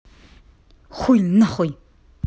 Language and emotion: Russian, angry